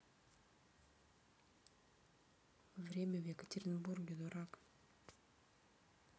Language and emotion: Russian, neutral